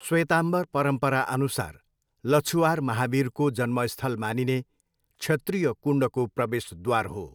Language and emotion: Nepali, neutral